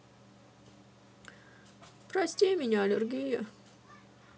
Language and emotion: Russian, sad